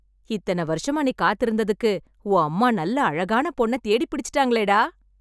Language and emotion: Tamil, happy